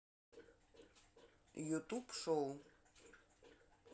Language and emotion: Russian, neutral